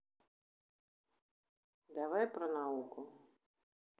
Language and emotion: Russian, neutral